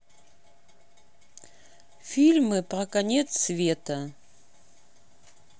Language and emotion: Russian, neutral